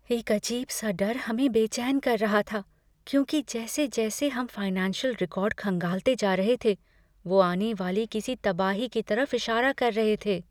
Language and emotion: Hindi, fearful